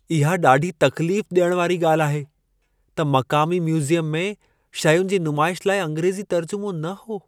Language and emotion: Sindhi, sad